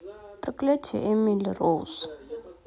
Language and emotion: Russian, neutral